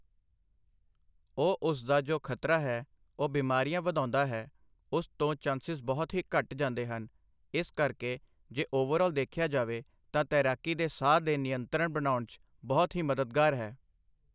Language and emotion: Punjabi, neutral